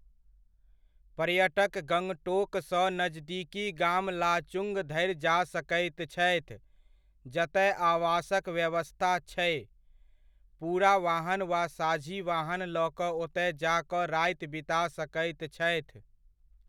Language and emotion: Maithili, neutral